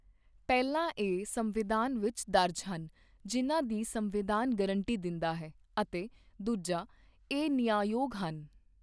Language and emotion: Punjabi, neutral